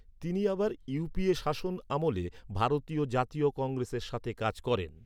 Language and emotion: Bengali, neutral